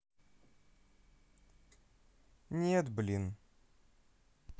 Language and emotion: Russian, sad